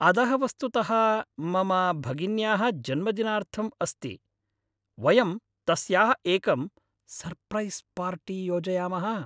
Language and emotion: Sanskrit, happy